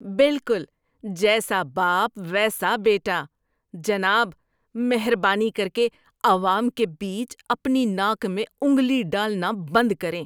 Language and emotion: Urdu, disgusted